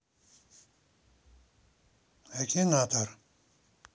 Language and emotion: Russian, neutral